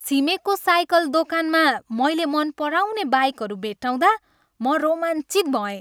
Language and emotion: Nepali, happy